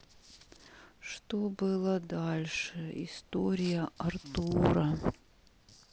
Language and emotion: Russian, sad